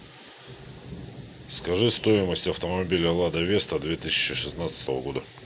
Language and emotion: Russian, neutral